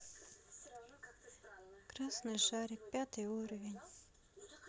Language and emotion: Russian, sad